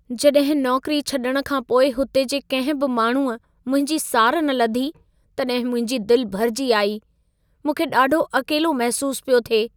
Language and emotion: Sindhi, sad